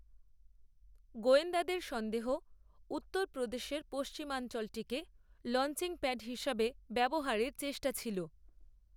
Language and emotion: Bengali, neutral